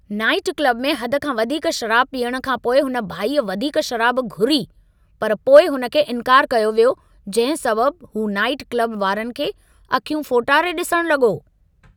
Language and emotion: Sindhi, angry